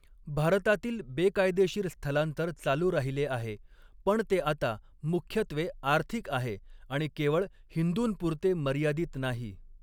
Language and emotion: Marathi, neutral